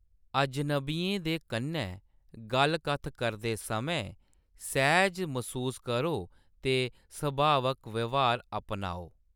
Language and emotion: Dogri, neutral